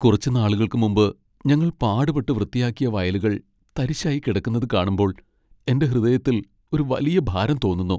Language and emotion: Malayalam, sad